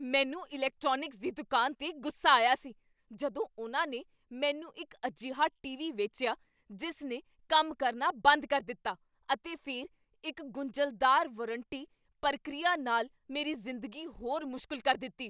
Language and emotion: Punjabi, angry